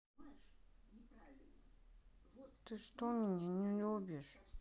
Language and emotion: Russian, sad